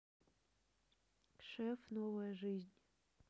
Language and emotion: Russian, neutral